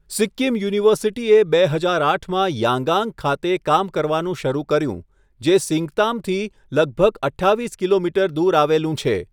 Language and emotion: Gujarati, neutral